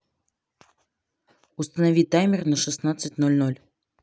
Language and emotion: Russian, neutral